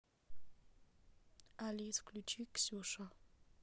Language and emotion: Russian, neutral